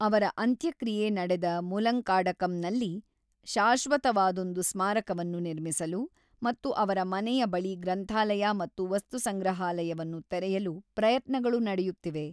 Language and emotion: Kannada, neutral